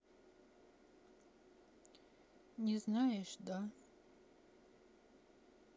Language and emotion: Russian, sad